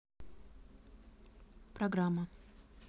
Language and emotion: Russian, neutral